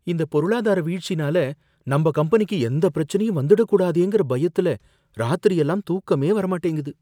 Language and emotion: Tamil, fearful